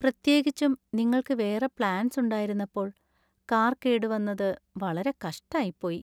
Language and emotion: Malayalam, sad